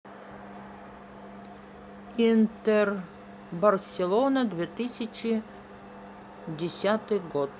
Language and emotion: Russian, neutral